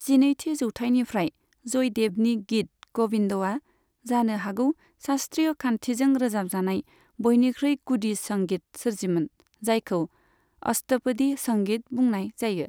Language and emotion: Bodo, neutral